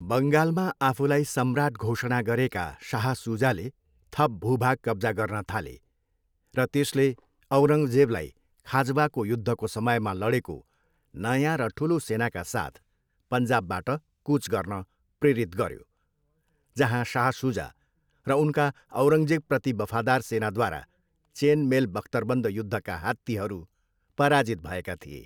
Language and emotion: Nepali, neutral